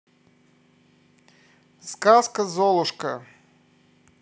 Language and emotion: Russian, positive